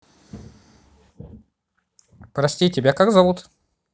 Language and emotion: Russian, neutral